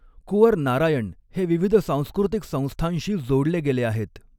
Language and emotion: Marathi, neutral